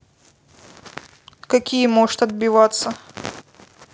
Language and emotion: Russian, neutral